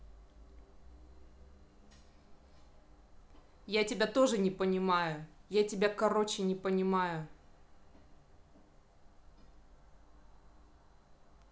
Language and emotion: Russian, angry